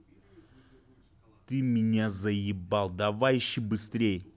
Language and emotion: Russian, angry